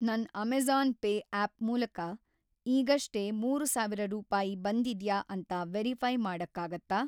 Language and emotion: Kannada, neutral